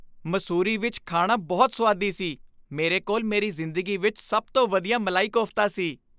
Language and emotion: Punjabi, happy